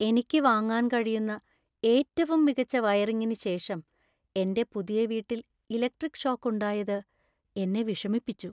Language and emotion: Malayalam, sad